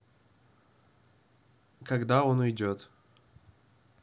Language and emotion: Russian, neutral